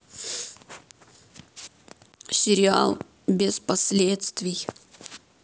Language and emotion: Russian, sad